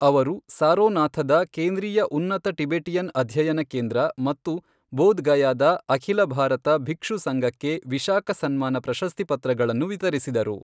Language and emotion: Kannada, neutral